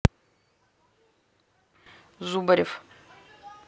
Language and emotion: Russian, neutral